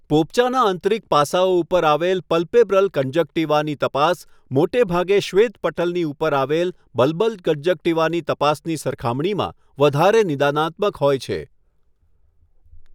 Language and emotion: Gujarati, neutral